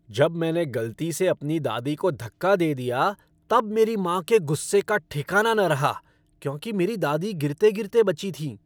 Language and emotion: Hindi, angry